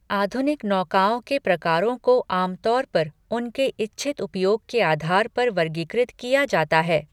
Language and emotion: Hindi, neutral